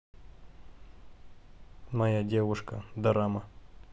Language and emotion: Russian, neutral